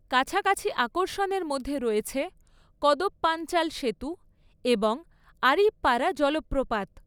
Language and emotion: Bengali, neutral